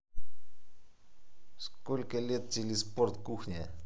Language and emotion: Russian, neutral